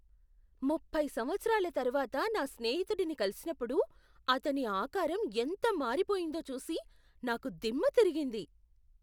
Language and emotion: Telugu, surprised